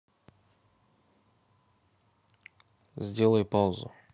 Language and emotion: Russian, neutral